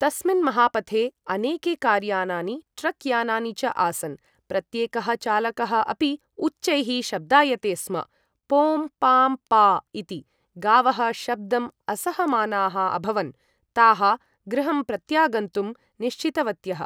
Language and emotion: Sanskrit, neutral